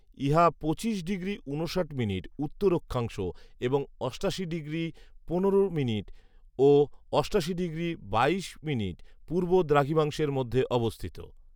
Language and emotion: Bengali, neutral